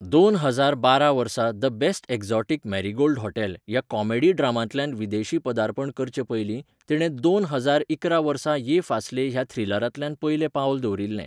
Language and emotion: Goan Konkani, neutral